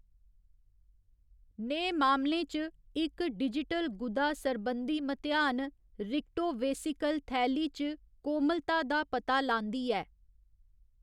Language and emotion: Dogri, neutral